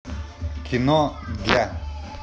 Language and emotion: Russian, neutral